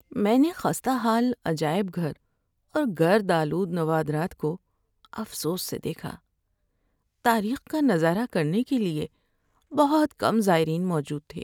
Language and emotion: Urdu, sad